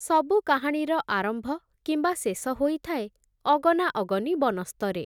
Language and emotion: Odia, neutral